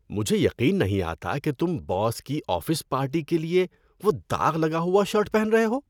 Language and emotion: Urdu, disgusted